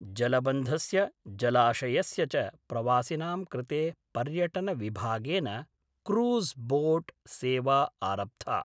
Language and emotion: Sanskrit, neutral